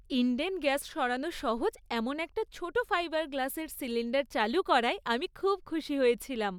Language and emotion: Bengali, happy